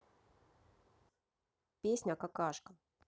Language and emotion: Russian, neutral